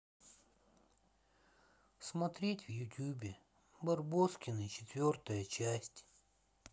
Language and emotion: Russian, sad